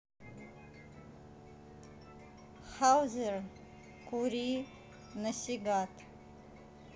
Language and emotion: Russian, neutral